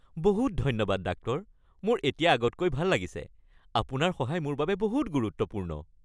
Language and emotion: Assamese, happy